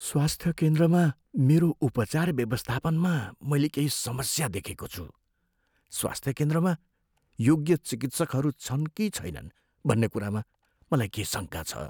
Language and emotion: Nepali, fearful